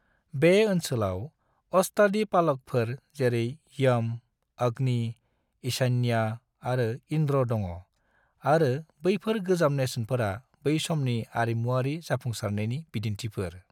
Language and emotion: Bodo, neutral